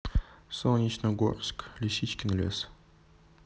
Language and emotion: Russian, neutral